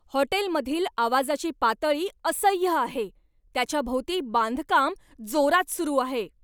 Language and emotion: Marathi, angry